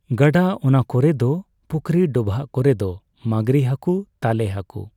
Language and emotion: Santali, neutral